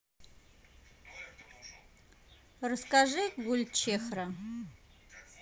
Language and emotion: Russian, neutral